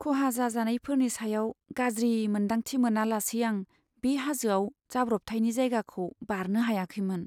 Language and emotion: Bodo, sad